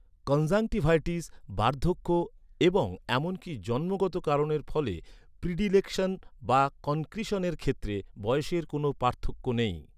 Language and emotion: Bengali, neutral